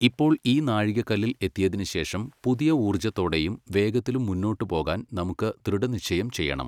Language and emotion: Malayalam, neutral